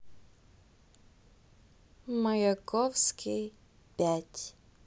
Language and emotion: Russian, neutral